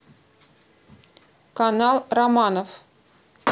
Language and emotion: Russian, neutral